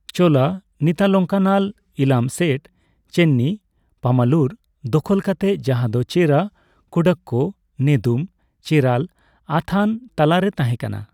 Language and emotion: Santali, neutral